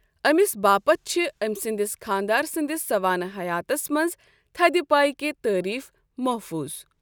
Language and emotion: Kashmiri, neutral